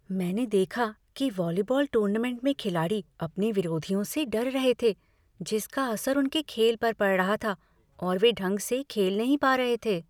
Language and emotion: Hindi, fearful